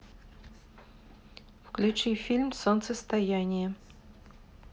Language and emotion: Russian, neutral